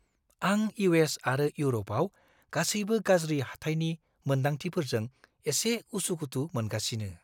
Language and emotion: Bodo, fearful